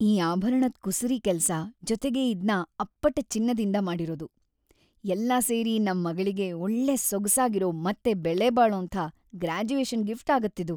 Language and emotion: Kannada, happy